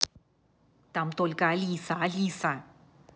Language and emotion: Russian, angry